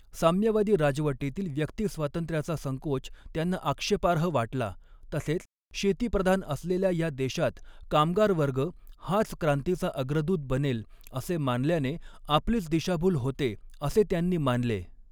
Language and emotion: Marathi, neutral